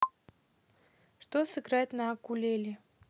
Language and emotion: Russian, neutral